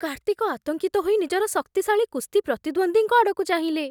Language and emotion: Odia, fearful